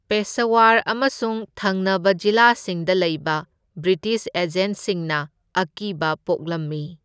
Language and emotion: Manipuri, neutral